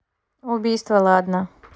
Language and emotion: Russian, neutral